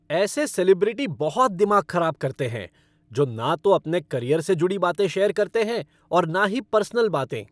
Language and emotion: Hindi, angry